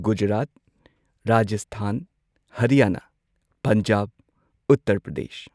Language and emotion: Manipuri, neutral